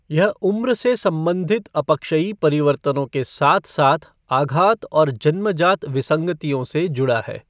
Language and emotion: Hindi, neutral